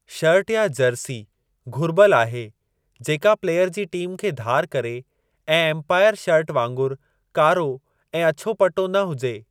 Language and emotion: Sindhi, neutral